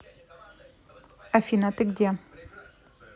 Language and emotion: Russian, neutral